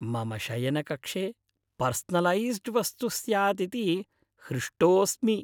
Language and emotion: Sanskrit, happy